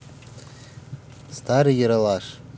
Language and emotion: Russian, neutral